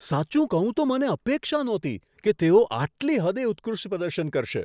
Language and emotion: Gujarati, surprised